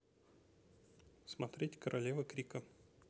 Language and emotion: Russian, neutral